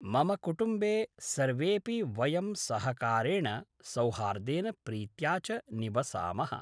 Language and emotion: Sanskrit, neutral